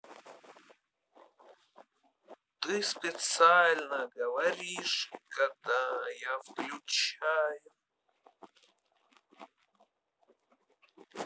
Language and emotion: Russian, positive